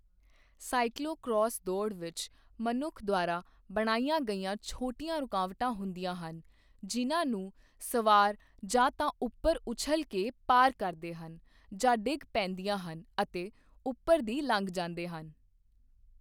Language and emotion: Punjabi, neutral